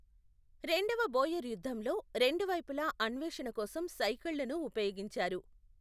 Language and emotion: Telugu, neutral